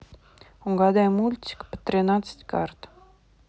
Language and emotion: Russian, neutral